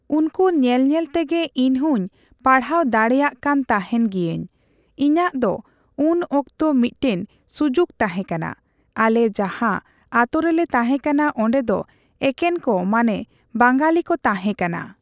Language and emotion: Santali, neutral